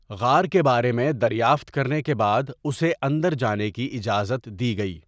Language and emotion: Urdu, neutral